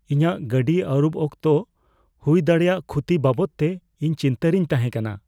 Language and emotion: Santali, fearful